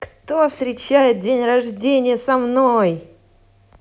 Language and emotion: Russian, positive